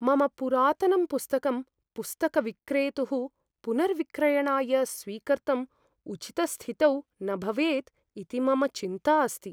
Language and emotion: Sanskrit, fearful